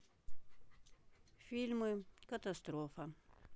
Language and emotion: Russian, neutral